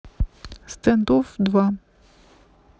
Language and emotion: Russian, neutral